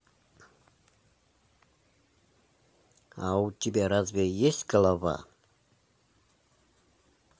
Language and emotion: Russian, neutral